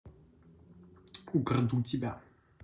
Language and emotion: Russian, neutral